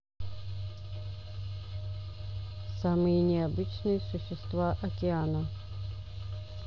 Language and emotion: Russian, neutral